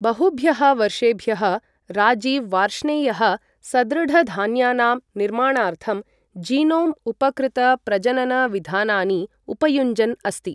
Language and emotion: Sanskrit, neutral